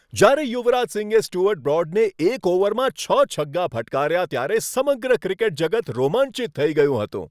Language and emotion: Gujarati, happy